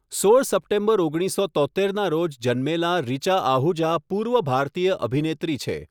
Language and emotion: Gujarati, neutral